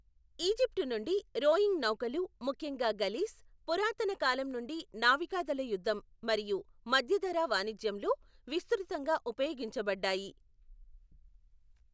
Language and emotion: Telugu, neutral